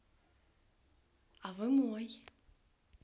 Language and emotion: Russian, positive